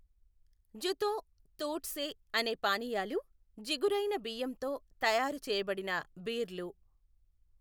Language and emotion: Telugu, neutral